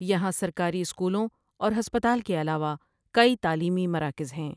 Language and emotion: Urdu, neutral